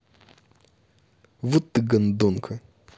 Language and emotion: Russian, angry